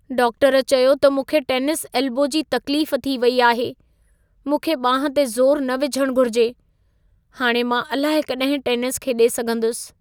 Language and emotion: Sindhi, sad